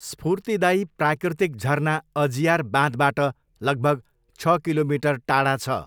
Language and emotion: Nepali, neutral